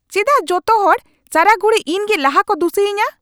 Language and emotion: Santali, angry